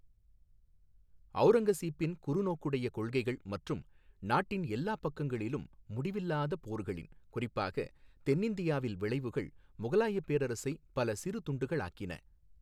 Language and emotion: Tamil, neutral